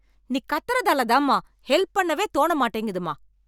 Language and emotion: Tamil, angry